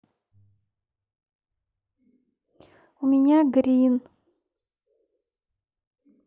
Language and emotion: Russian, neutral